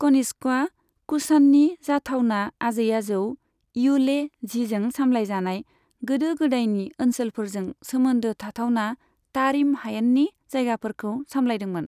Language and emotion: Bodo, neutral